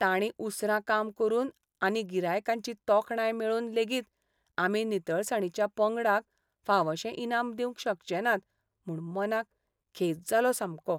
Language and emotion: Goan Konkani, sad